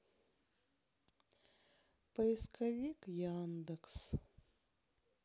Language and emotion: Russian, sad